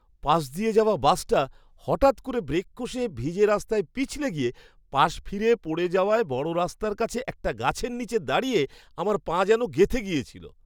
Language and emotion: Bengali, surprised